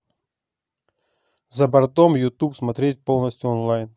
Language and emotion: Russian, neutral